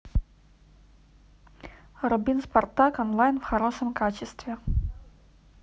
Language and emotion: Russian, neutral